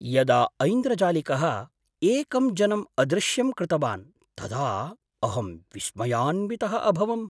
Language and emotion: Sanskrit, surprised